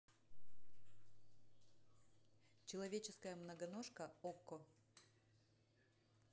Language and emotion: Russian, neutral